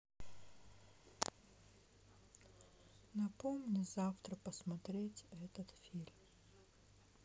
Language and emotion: Russian, sad